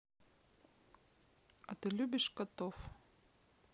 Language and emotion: Russian, neutral